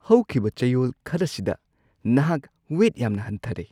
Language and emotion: Manipuri, surprised